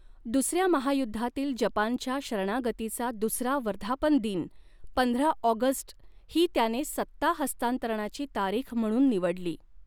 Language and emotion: Marathi, neutral